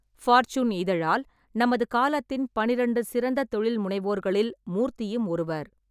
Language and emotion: Tamil, neutral